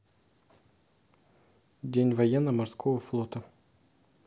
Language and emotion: Russian, neutral